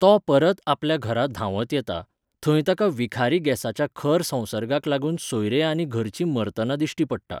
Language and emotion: Goan Konkani, neutral